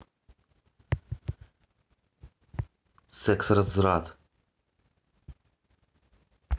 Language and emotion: Russian, neutral